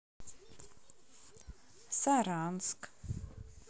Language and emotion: Russian, neutral